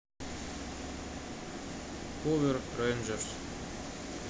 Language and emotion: Russian, neutral